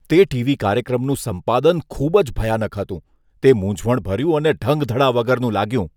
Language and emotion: Gujarati, disgusted